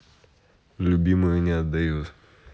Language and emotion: Russian, neutral